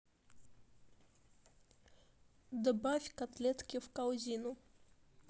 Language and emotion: Russian, neutral